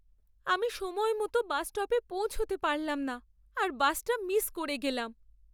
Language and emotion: Bengali, sad